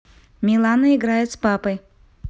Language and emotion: Russian, neutral